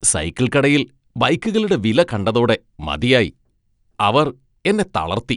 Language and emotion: Malayalam, disgusted